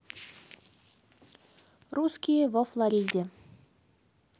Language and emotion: Russian, neutral